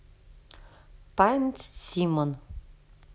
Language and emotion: Russian, neutral